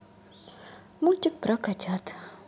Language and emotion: Russian, sad